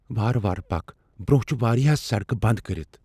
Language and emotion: Kashmiri, fearful